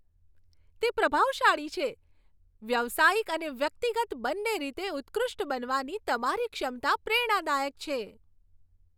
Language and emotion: Gujarati, happy